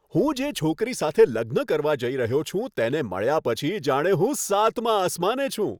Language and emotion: Gujarati, happy